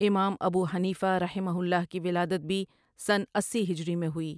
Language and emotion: Urdu, neutral